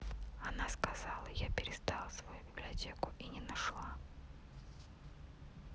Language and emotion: Russian, neutral